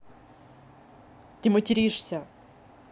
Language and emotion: Russian, angry